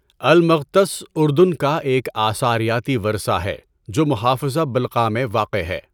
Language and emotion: Urdu, neutral